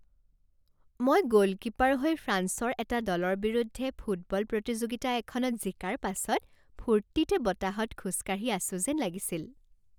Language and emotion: Assamese, happy